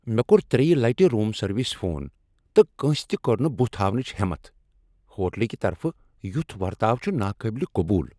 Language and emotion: Kashmiri, angry